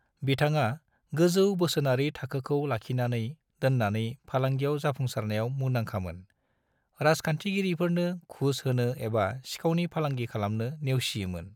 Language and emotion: Bodo, neutral